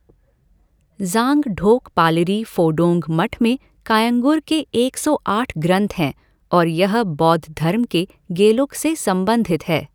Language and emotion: Hindi, neutral